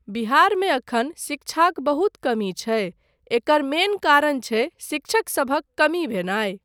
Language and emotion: Maithili, neutral